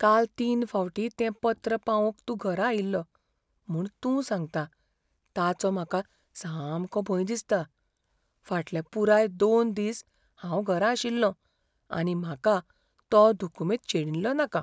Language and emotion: Goan Konkani, fearful